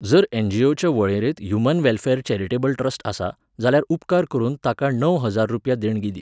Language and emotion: Goan Konkani, neutral